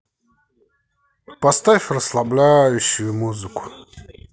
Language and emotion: Russian, neutral